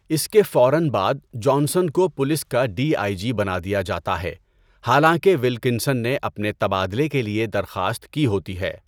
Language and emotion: Urdu, neutral